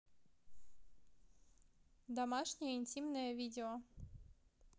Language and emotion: Russian, neutral